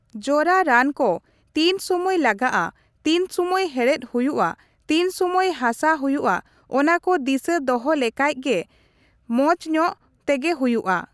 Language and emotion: Santali, neutral